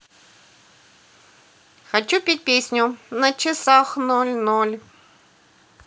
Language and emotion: Russian, positive